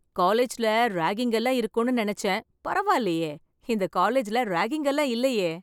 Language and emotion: Tamil, happy